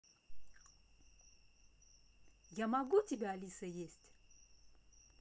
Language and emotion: Russian, positive